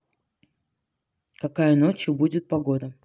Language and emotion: Russian, neutral